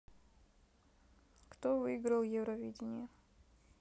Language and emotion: Russian, neutral